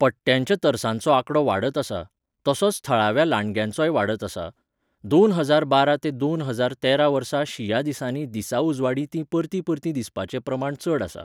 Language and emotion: Goan Konkani, neutral